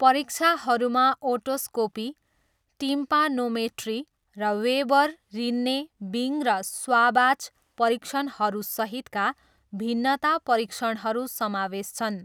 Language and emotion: Nepali, neutral